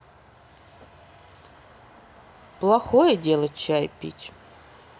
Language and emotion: Russian, sad